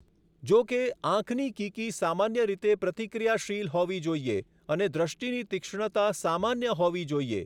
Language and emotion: Gujarati, neutral